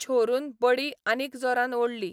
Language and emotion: Goan Konkani, neutral